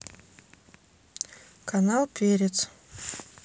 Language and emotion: Russian, neutral